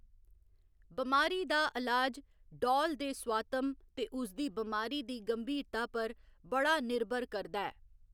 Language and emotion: Dogri, neutral